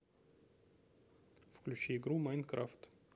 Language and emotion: Russian, neutral